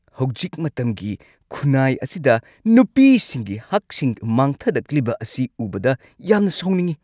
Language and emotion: Manipuri, angry